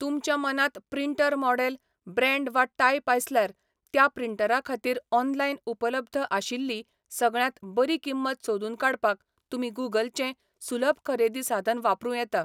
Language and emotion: Goan Konkani, neutral